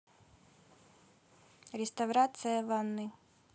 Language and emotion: Russian, neutral